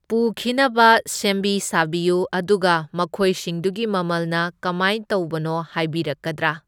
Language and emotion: Manipuri, neutral